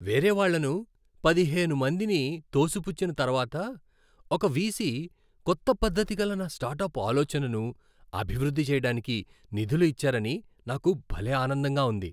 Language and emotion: Telugu, happy